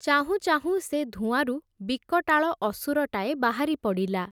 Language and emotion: Odia, neutral